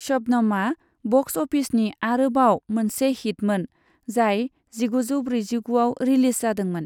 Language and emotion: Bodo, neutral